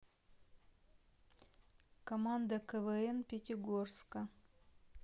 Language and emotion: Russian, neutral